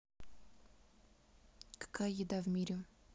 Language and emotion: Russian, neutral